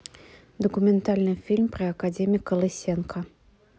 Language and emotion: Russian, neutral